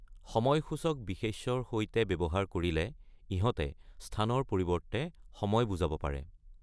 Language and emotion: Assamese, neutral